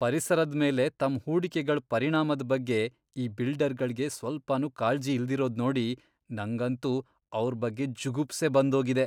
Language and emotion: Kannada, disgusted